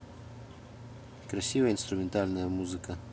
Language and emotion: Russian, neutral